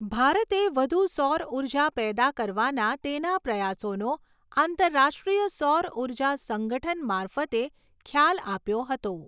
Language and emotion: Gujarati, neutral